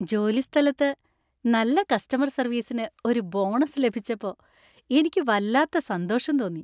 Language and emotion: Malayalam, happy